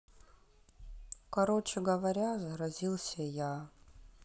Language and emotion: Russian, sad